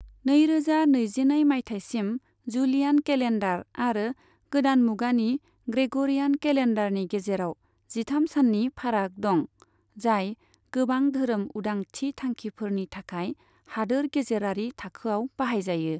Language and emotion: Bodo, neutral